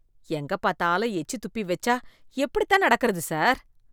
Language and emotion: Tamil, disgusted